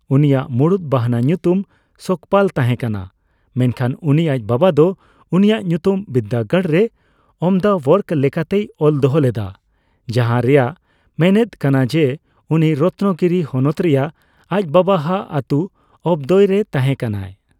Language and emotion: Santali, neutral